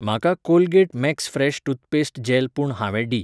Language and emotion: Goan Konkani, neutral